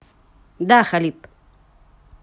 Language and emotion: Russian, neutral